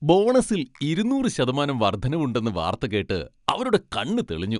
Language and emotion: Malayalam, happy